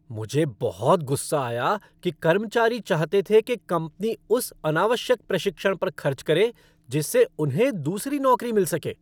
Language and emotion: Hindi, angry